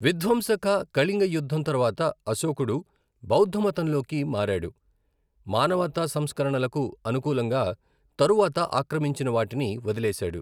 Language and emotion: Telugu, neutral